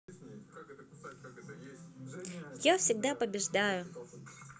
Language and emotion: Russian, positive